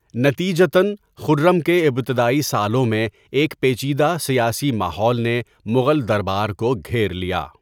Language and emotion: Urdu, neutral